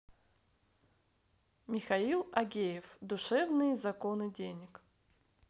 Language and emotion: Russian, positive